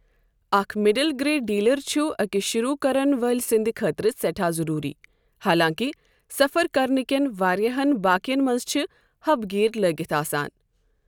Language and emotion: Kashmiri, neutral